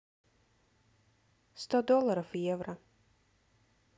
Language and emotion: Russian, neutral